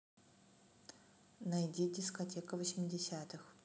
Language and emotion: Russian, neutral